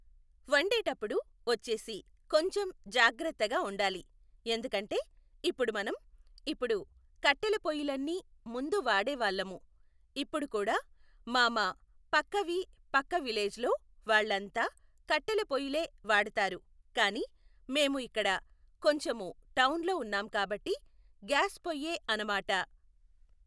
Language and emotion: Telugu, neutral